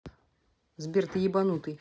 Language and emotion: Russian, angry